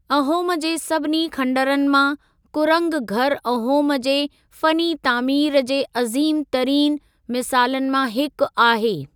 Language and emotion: Sindhi, neutral